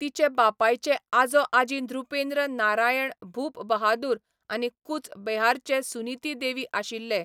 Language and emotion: Goan Konkani, neutral